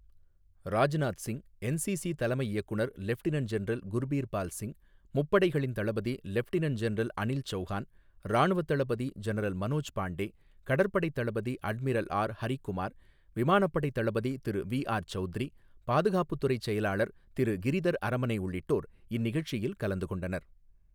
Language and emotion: Tamil, neutral